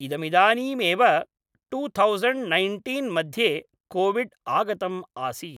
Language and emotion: Sanskrit, neutral